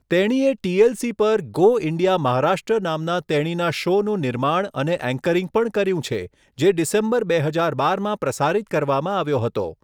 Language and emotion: Gujarati, neutral